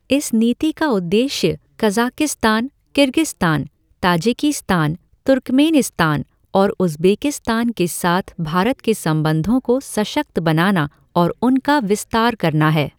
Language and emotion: Hindi, neutral